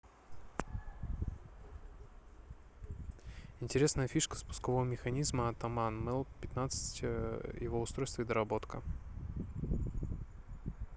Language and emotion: Russian, neutral